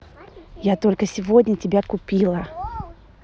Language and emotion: Russian, positive